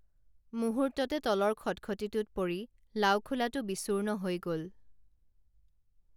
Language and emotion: Assamese, neutral